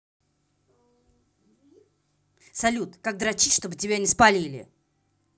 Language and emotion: Russian, angry